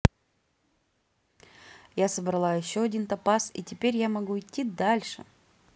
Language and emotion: Russian, positive